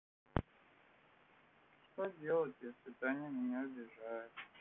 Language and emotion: Russian, sad